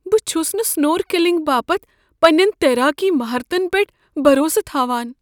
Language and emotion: Kashmiri, fearful